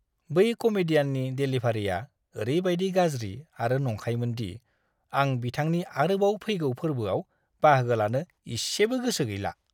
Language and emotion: Bodo, disgusted